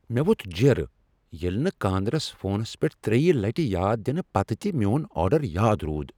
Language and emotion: Kashmiri, angry